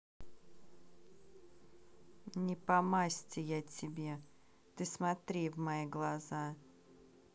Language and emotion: Russian, neutral